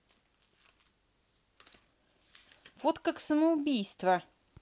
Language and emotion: Russian, angry